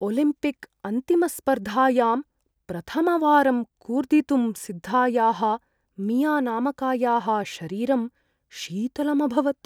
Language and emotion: Sanskrit, fearful